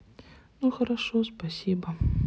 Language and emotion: Russian, sad